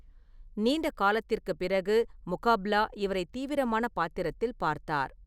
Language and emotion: Tamil, neutral